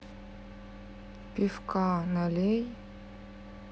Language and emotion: Russian, neutral